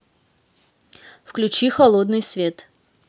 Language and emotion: Russian, neutral